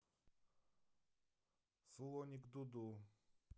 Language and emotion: Russian, neutral